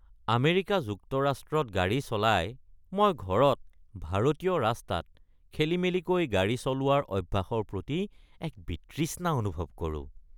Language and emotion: Assamese, disgusted